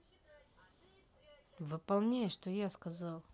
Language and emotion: Russian, angry